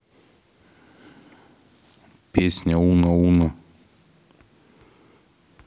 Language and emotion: Russian, neutral